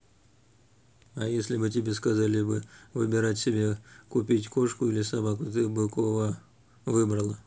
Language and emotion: Russian, neutral